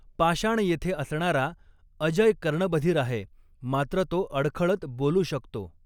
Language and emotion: Marathi, neutral